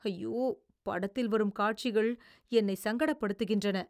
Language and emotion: Tamil, disgusted